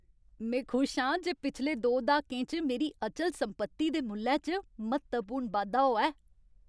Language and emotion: Dogri, happy